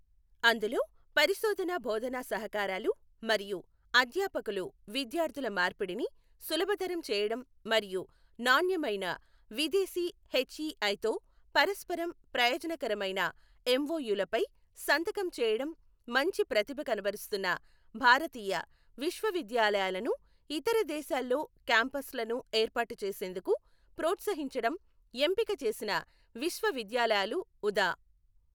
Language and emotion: Telugu, neutral